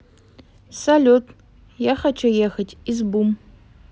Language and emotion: Russian, neutral